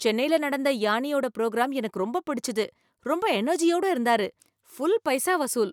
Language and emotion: Tamil, happy